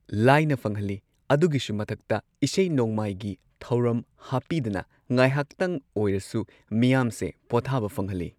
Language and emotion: Manipuri, neutral